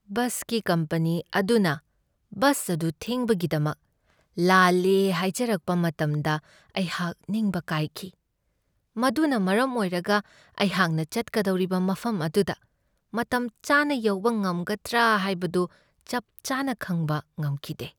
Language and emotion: Manipuri, sad